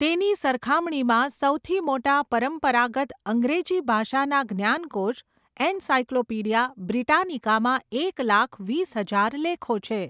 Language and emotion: Gujarati, neutral